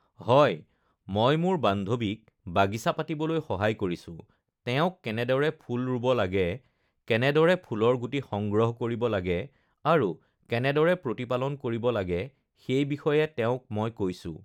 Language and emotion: Assamese, neutral